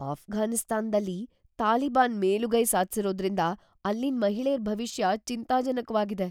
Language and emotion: Kannada, fearful